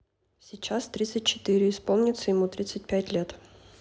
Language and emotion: Russian, neutral